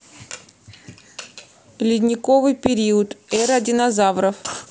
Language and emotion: Russian, neutral